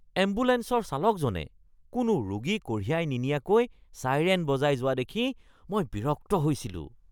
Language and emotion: Assamese, disgusted